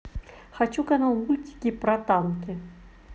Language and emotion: Russian, positive